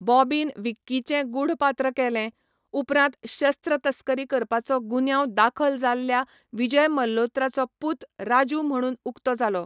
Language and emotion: Goan Konkani, neutral